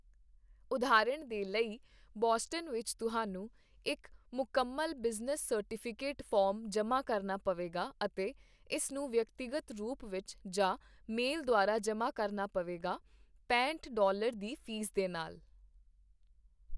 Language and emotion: Punjabi, neutral